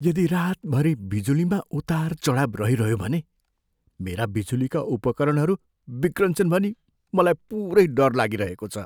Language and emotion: Nepali, fearful